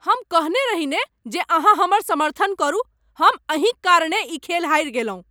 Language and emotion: Maithili, angry